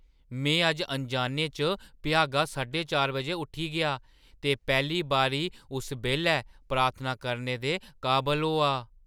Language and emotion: Dogri, surprised